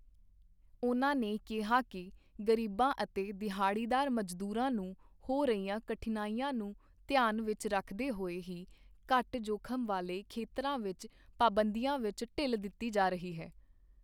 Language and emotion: Punjabi, neutral